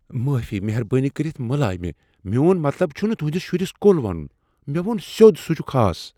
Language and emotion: Kashmiri, fearful